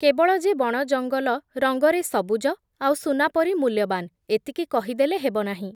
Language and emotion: Odia, neutral